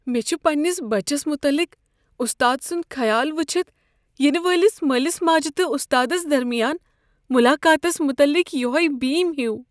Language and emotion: Kashmiri, fearful